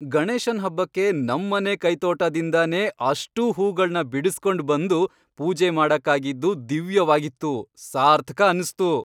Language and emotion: Kannada, happy